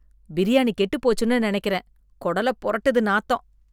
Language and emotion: Tamil, disgusted